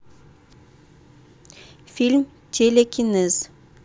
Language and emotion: Russian, neutral